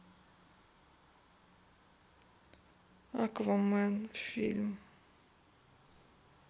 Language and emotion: Russian, sad